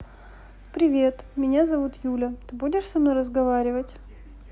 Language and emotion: Russian, neutral